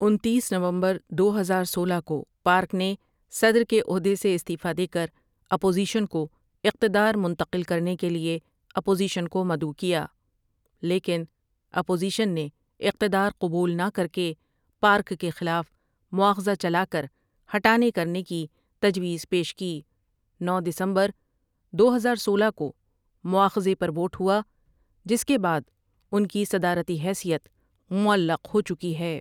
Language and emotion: Urdu, neutral